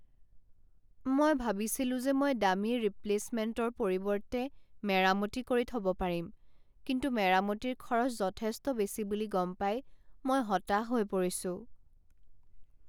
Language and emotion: Assamese, sad